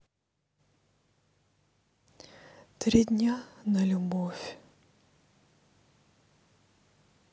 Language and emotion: Russian, sad